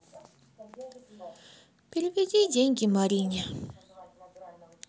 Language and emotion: Russian, sad